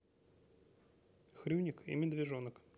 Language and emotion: Russian, neutral